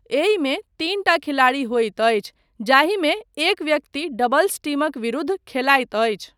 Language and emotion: Maithili, neutral